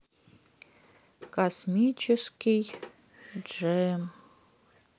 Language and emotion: Russian, sad